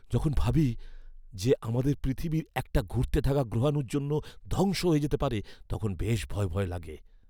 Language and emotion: Bengali, fearful